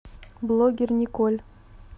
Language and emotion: Russian, neutral